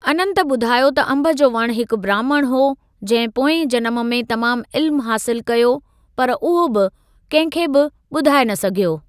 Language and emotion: Sindhi, neutral